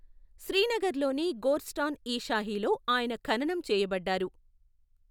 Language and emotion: Telugu, neutral